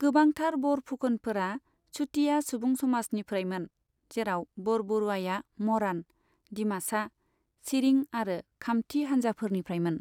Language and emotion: Bodo, neutral